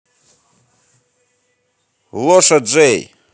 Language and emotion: Russian, positive